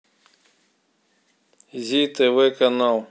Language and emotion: Russian, neutral